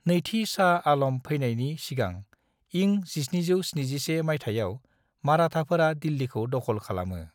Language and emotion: Bodo, neutral